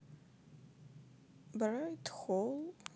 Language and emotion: Russian, neutral